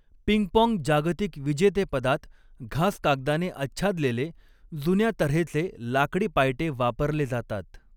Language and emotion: Marathi, neutral